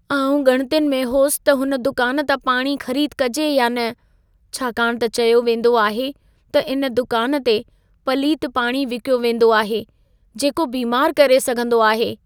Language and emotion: Sindhi, fearful